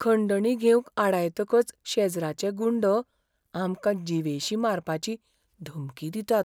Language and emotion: Goan Konkani, fearful